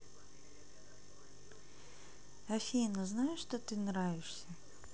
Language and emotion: Russian, neutral